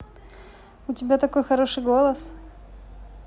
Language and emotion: Russian, positive